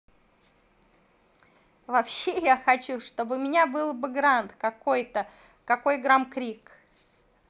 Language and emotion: Russian, positive